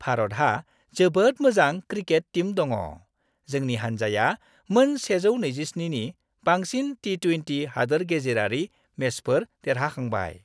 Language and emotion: Bodo, happy